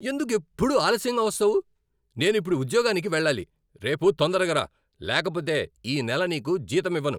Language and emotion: Telugu, angry